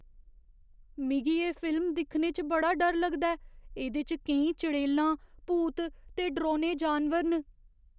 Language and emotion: Dogri, fearful